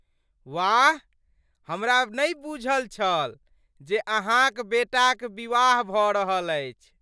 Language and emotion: Maithili, surprised